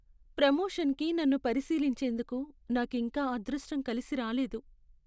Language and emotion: Telugu, sad